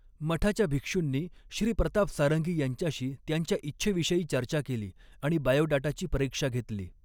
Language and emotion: Marathi, neutral